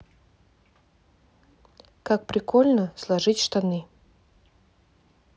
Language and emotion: Russian, neutral